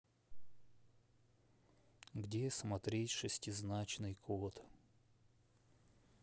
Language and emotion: Russian, sad